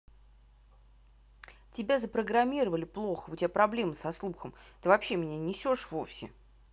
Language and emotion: Russian, angry